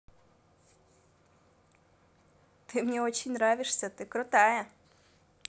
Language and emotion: Russian, positive